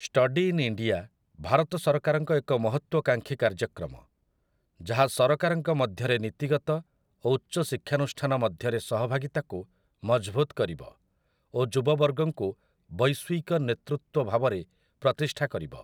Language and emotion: Odia, neutral